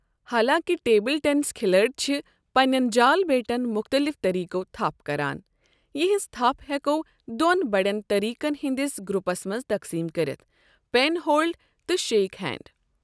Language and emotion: Kashmiri, neutral